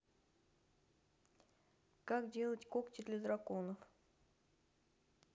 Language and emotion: Russian, neutral